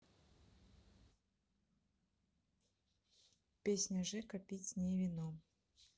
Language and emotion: Russian, neutral